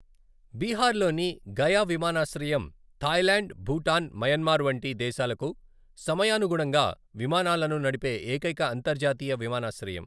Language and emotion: Telugu, neutral